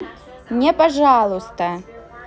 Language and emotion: Russian, neutral